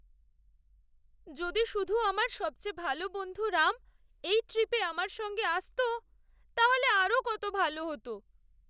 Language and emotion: Bengali, sad